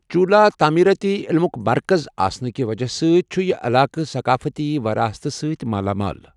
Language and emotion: Kashmiri, neutral